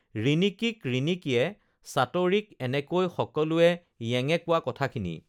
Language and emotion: Assamese, neutral